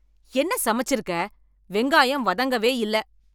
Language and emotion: Tamil, angry